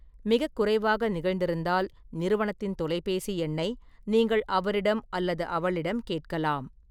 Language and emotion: Tamil, neutral